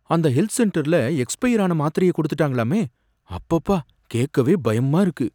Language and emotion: Tamil, fearful